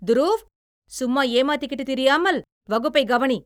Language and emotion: Tamil, angry